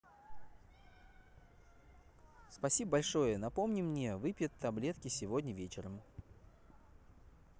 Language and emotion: Russian, positive